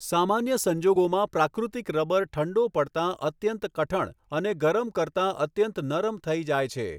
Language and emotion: Gujarati, neutral